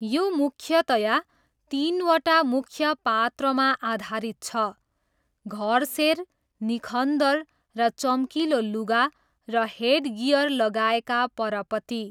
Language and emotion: Nepali, neutral